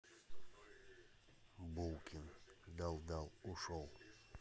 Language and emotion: Russian, neutral